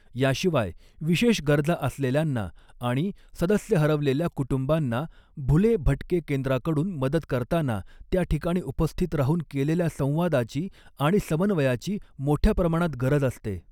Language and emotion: Marathi, neutral